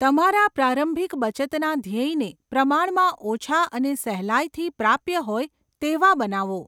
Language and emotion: Gujarati, neutral